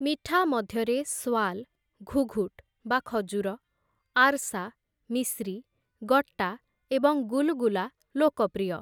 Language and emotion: Odia, neutral